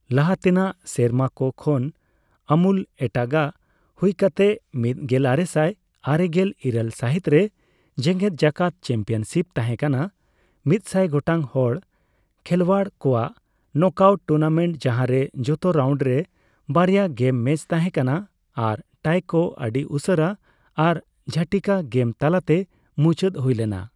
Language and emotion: Santali, neutral